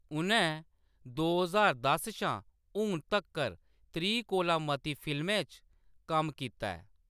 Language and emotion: Dogri, neutral